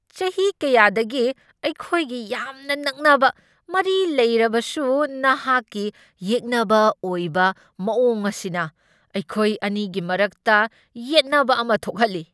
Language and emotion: Manipuri, angry